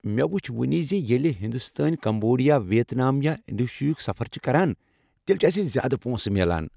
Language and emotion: Kashmiri, happy